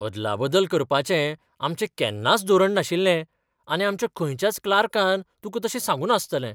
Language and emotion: Goan Konkani, surprised